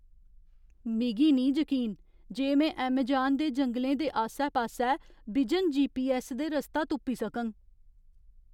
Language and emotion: Dogri, fearful